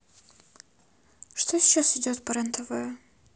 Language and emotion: Russian, sad